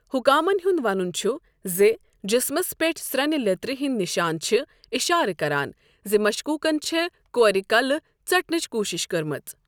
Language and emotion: Kashmiri, neutral